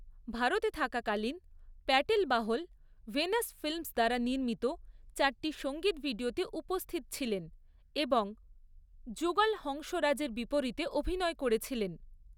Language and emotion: Bengali, neutral